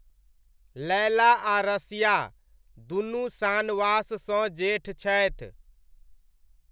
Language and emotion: Maithili, neutral